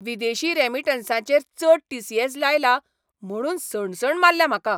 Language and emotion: Goan Konkani, angry